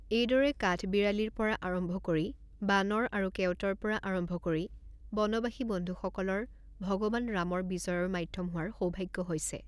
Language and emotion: Assamese, neutral